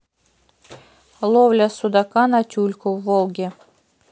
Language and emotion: Russian, neutral